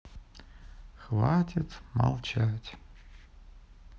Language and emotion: Russian, sad